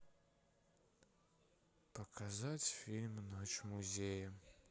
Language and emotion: Russian, sad